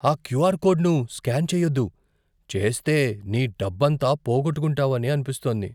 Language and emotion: Telugu, fearful